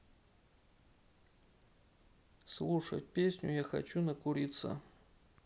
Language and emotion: Russian, neutral